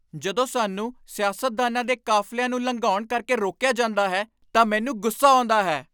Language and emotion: Punjabi, angry